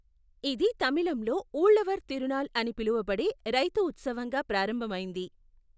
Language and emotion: Telugu, neutral